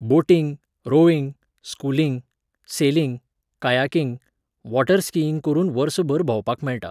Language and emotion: Goan Konkani, neutral